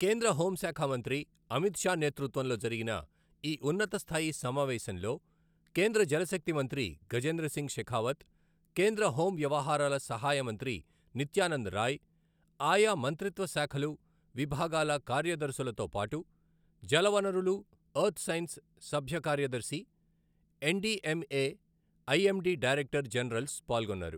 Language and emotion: Telugu, neutral